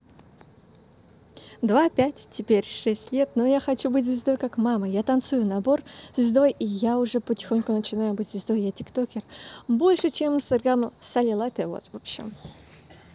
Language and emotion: Russian, positive